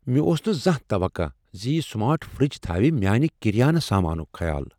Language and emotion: Kashmiri, surprised